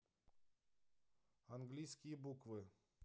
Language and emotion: Russian, neutral